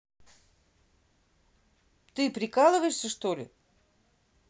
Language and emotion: Russian, angry